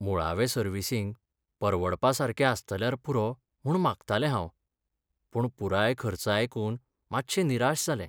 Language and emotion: Goan Konkani, sad